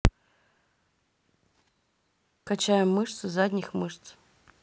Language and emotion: Russian, neutral